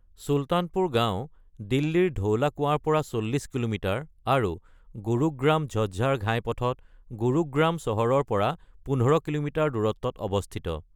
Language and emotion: Assamese, neutral